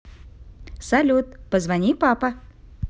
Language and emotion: Russian, positive